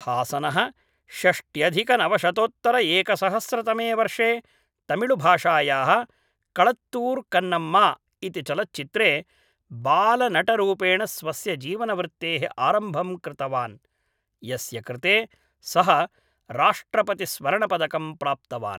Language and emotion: Sanskrit, neutral